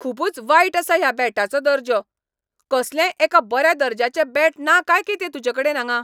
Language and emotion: Goan Konkani, angry